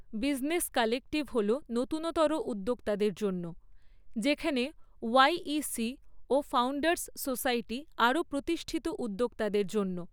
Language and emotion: Bengali, neutral